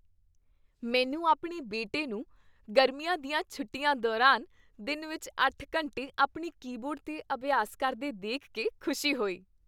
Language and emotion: Punjabi, happy